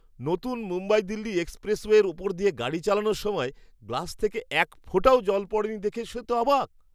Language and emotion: Bengali, surprised